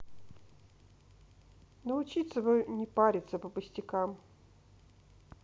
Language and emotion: Russian, neutral